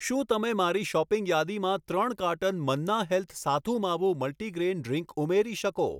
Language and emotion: Gujarati, neutral